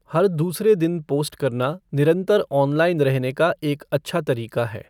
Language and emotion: Hindi, neutral